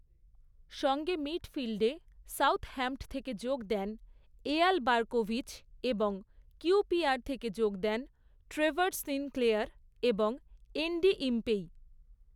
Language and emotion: Bengali, neutral